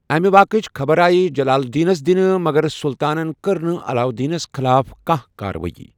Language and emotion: Kashmiri, neutral